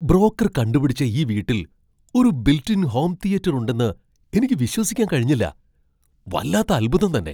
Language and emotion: Malayalam, surprised